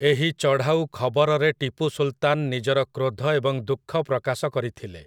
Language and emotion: Odia, neutral